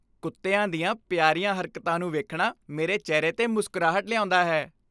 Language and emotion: Punjabi, happy